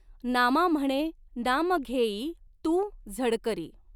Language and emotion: Marathi, neutral